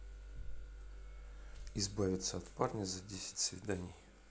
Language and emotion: Russian, neutral